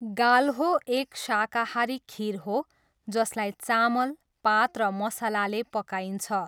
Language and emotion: Nepali, neutral